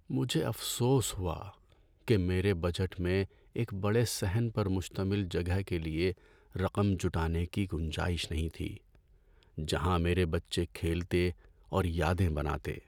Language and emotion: Urdu, sad